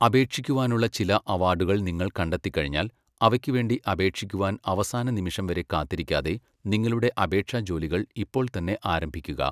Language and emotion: Malayalam, neutral